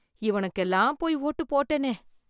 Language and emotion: Tamil, disgusted